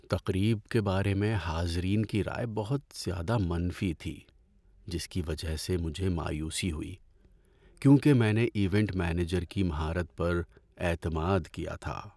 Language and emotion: Urdu, sad